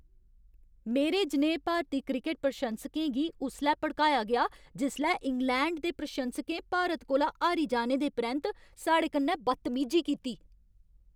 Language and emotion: Dogri, angry